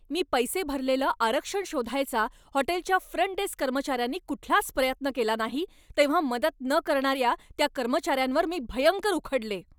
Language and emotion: Marathi, angry